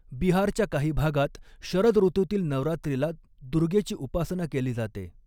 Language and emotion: Marathi, neutral